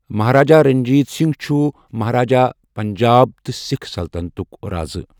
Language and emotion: Kashmiri, neutral